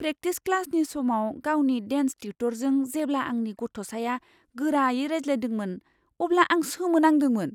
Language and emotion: Bodo, surprised